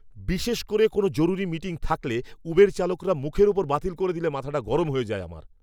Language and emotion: Bengali, angry